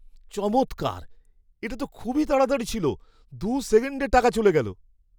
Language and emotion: Bengali, surprised